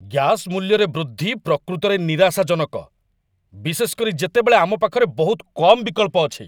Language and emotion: Odia, angry